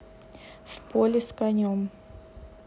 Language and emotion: Russian, neutral